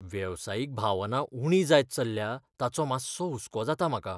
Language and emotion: Goan Konkani, fearful